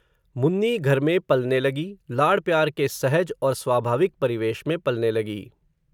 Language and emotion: Hindi, neutral